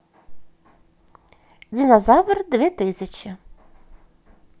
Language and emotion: Russian, positive